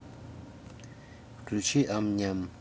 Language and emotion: Russian, neutral